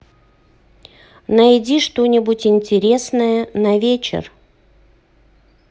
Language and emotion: Russian, neutral